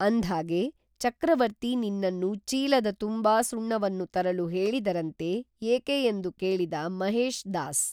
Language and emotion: Kannada, neutral